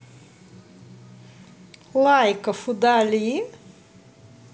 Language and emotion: Russian, positive